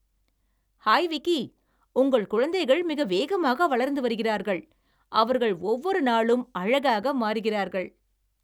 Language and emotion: Tamil, happy